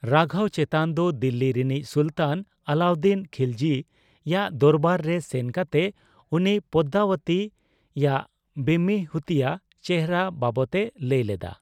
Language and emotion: Santali, neutral